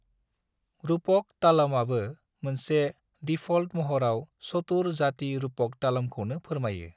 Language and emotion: Bodo, neutral